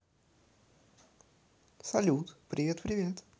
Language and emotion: Russian, positive